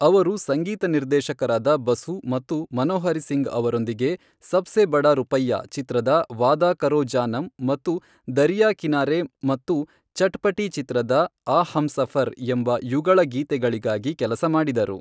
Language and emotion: Kannada, neutral